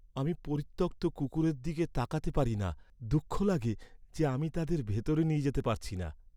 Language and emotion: Bengali, sad